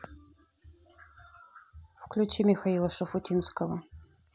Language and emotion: Russian, neutral